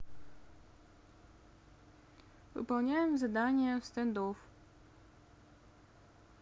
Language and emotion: Russian, neutral